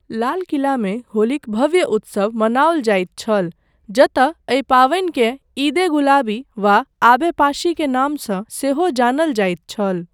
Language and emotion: Maithili, neutral